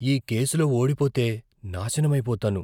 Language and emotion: Telugu, fearful